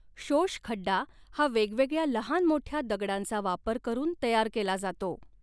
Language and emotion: Marathi, neutral